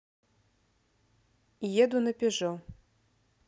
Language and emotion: Russian, neutral